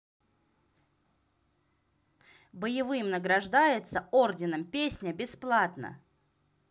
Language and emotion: Russian, neutral